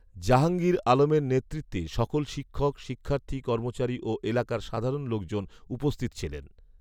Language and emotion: Bengali, neutral